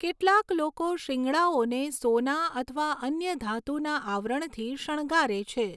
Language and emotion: Gujarati, neutral